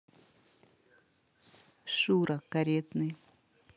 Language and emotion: Russian, neutral